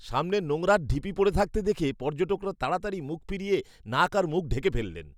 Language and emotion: Bengali, disgusted